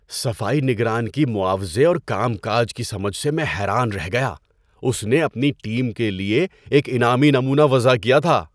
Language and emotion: Urdu, surprised